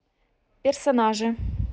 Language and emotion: Russian, neutral